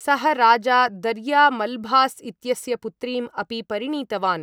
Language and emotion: Sanskrit, neutral